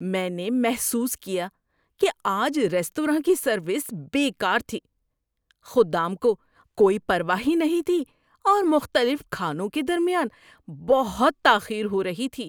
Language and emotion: Urdu, disgusted